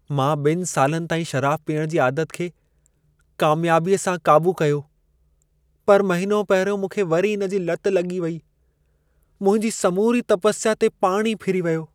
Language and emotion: Sindhi, sad